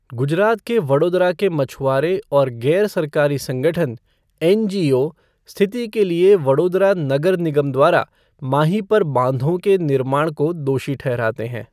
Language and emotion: Hindi, neutral